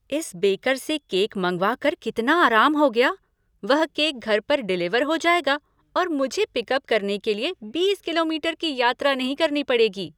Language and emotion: Hindi, happy